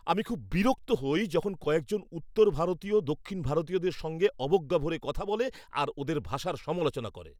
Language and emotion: Bengali, angry